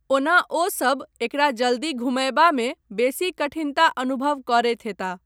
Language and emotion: Maithili, neutral